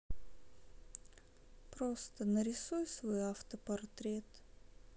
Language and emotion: Russian, sad